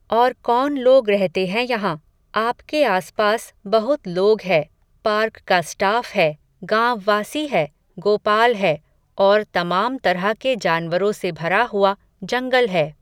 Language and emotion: Hindi, neutral